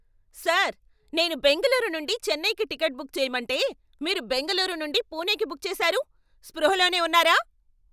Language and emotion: Telugu, angry